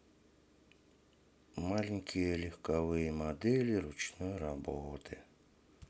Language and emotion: Russian, sad